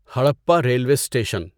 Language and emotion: Urdu, neutral